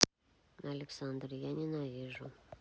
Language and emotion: Russian, neutral